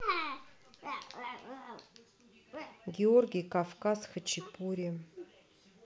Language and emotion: Russian, neutral